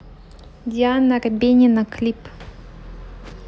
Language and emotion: Russian, neutral